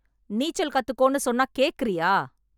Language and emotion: Tamil, angry